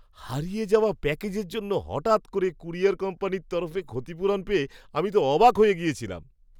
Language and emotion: Bengali, surprised